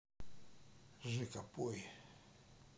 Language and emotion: Russian, sad